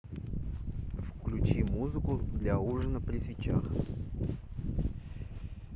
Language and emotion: Russian, neutral